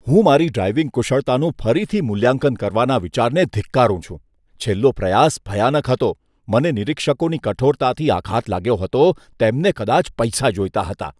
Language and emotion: Gujarati, disgusted